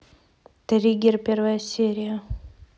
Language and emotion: Russian, neutral